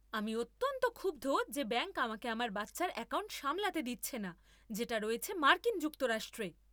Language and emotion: Bengali, angry